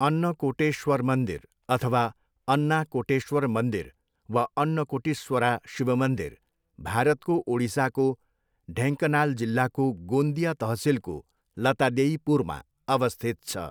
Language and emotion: Nepali, neutral